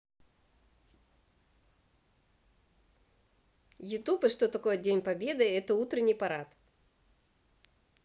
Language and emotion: Russian, positive